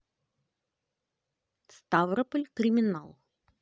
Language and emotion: Russian, neutral